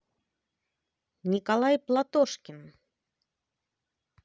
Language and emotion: Russian, positive